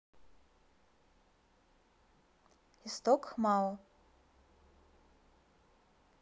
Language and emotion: Russian, neutral